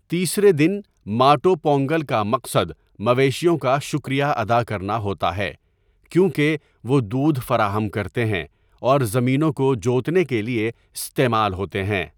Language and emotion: Urdu, neutral